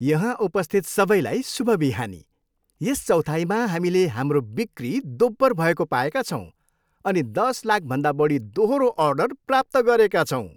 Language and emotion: Nepali, happy